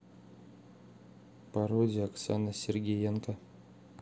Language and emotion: Russian, neutral